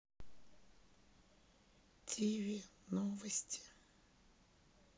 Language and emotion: Russian, sad